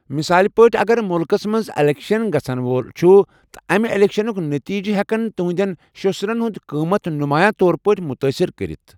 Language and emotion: Kashmiri, neutral